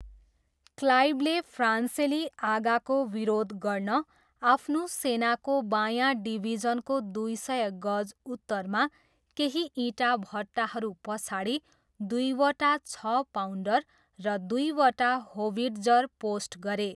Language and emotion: Nepali, neutral